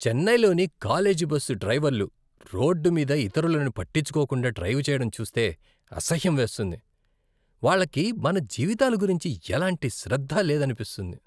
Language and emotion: Telugu, disgusted